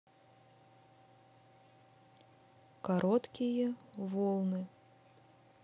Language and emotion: Russian, neutral